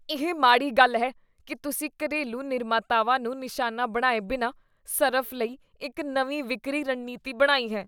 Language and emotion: Punjabi, disgusted